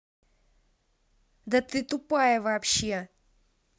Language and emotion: Russian, angry